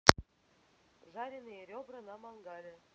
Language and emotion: Russian, neutral